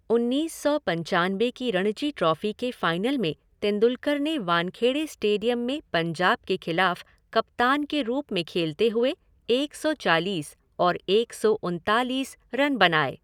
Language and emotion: Hindi, neutral